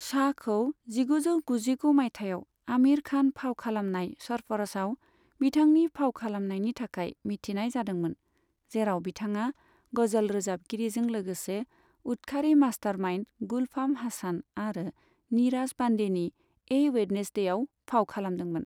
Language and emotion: Bodo, neutral